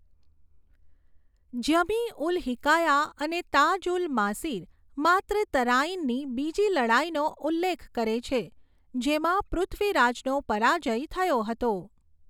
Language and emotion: Gujarati, neutral